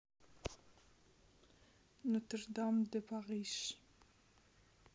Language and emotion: Russian, neutral